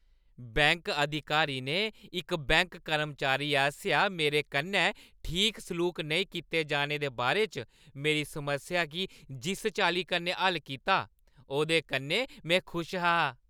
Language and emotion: Dogri, happy